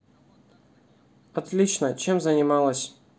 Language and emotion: Russian, neutral